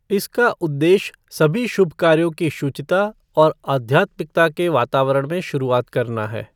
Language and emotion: Hindi, neutral